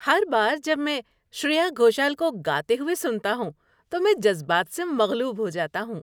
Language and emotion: Urdu, happy